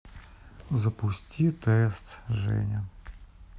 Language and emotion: Russian, sad